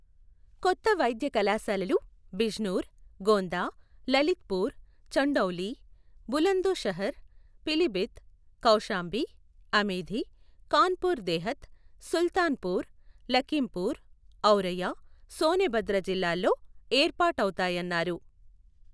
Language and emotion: Telugu, neutral